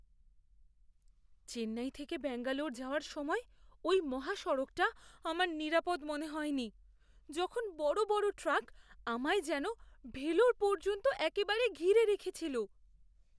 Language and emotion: Bengali, fearful